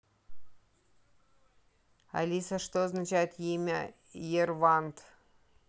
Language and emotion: Russian, neutral